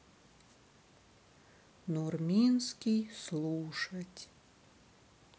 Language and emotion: Russian, sad